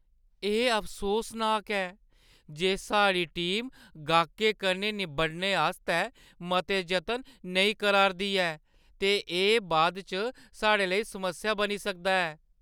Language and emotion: Dogri, sad